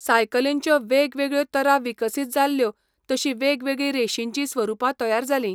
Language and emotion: Goan Konkani, neutral